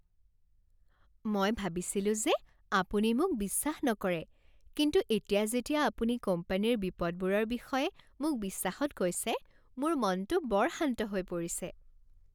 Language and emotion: Assamese, happy